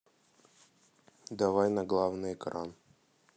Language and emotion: Russian, neutral